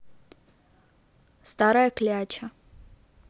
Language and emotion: Russian, neutral